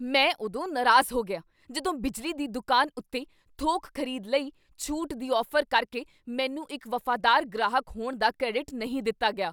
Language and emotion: Punjabi, angry